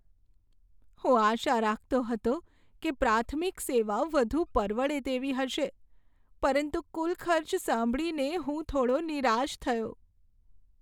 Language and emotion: Gujarati, sad